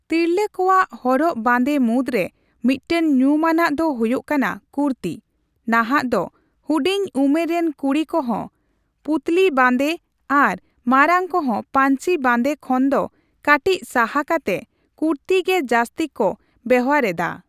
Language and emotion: Santali, neutral